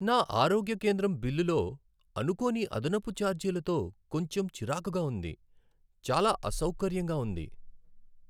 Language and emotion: Telugu, sad